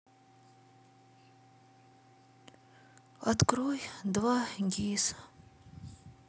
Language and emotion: Russian, sad